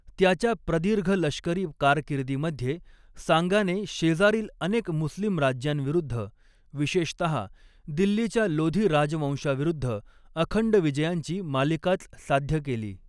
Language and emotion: Marathi, neutral